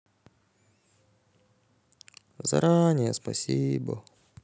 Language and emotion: Russian, sad